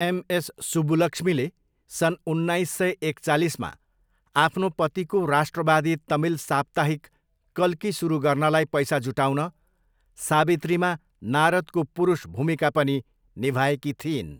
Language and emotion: Nepali, neutral